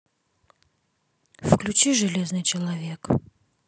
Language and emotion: Russian, neutral